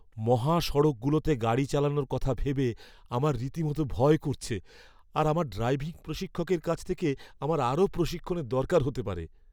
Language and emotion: Bengali, fearful